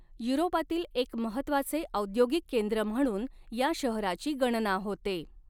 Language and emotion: Marathi, neutral